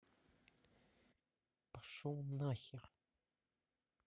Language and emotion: Russian, angry